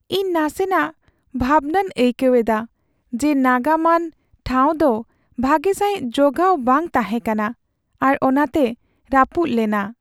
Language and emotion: Santali, sad